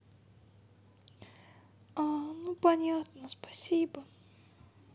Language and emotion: Russian, sad